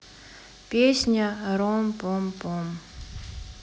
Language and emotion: Russian, sad